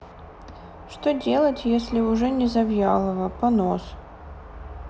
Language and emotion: Russian, sad